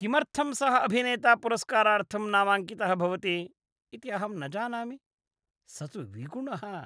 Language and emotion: Sanskrit, disgusted